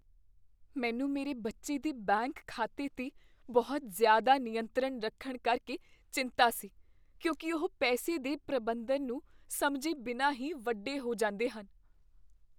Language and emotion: Punjabi, fearful